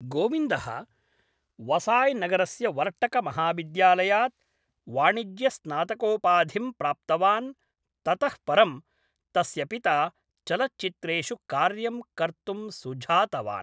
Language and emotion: Sanskrit, neutral